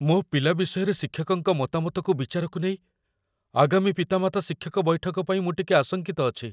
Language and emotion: Odia, fearful